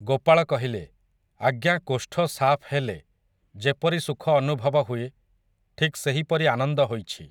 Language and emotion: Odia, neutral